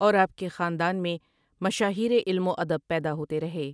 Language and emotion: Urdu, neutral